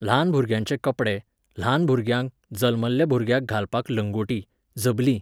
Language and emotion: Goan Konkani, neutral